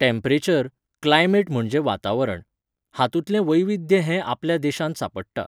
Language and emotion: Goan Konkani, neutral